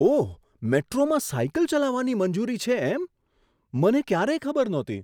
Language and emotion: Gujarati, surprised